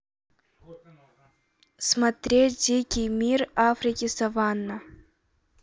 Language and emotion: Russian, neutral